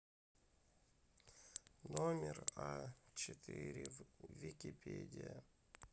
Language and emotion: Russian, sad